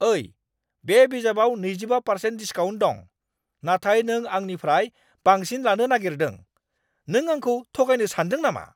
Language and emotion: Bodo, angry